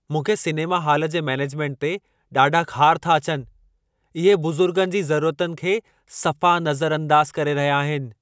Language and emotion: Sindhi, angry